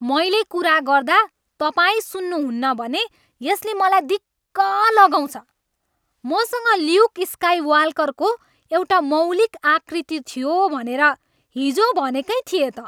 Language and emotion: Nepali, angry